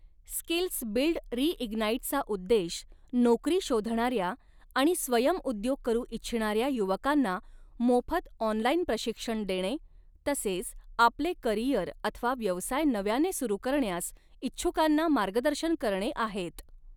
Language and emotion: Marathi, neutral